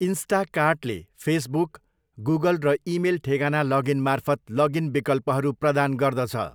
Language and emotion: Nepali, neutral